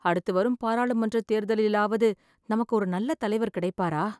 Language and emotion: Tamil, sad